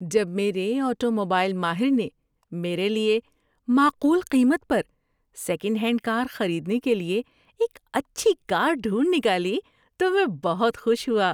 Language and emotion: Urdu, happy